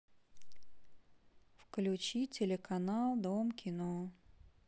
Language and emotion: Russian, neutral